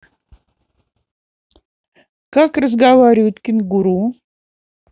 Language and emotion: Russian, neutral